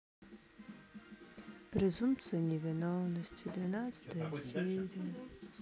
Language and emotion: Russian, sad